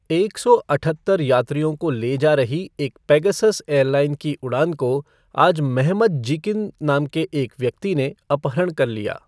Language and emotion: Hindi, neutral